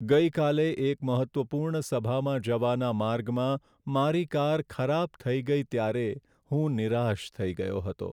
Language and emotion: Gujarati, sad